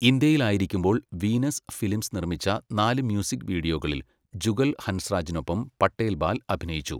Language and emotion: Malayalam, neutral